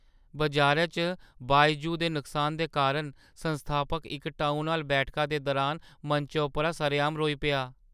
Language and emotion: Dogri, sad